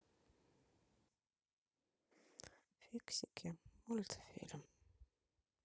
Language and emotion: Russian, sad